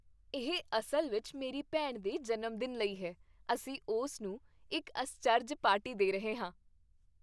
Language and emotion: Punjabi, happy